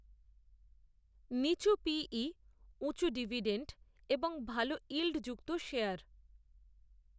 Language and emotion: Bengali, neutral